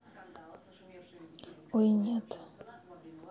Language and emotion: Russian, sad